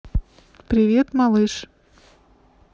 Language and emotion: Russian, neutral